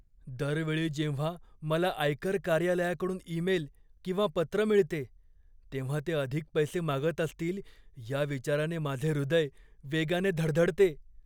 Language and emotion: Marathi, fearful